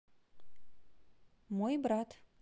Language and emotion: Russian, neutral